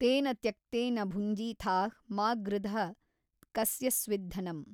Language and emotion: Kannada, neutral